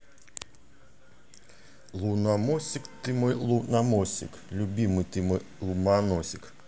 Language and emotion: Russian, positive